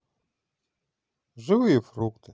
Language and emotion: Russian, positive